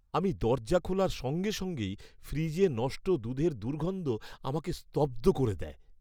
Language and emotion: Bengali, disgusted